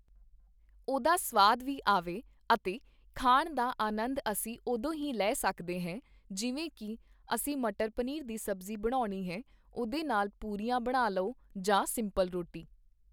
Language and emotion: Punjabi, neutral